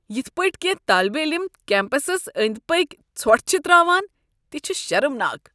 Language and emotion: Kashmiri, disgusted